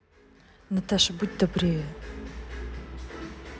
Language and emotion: Russian, neutral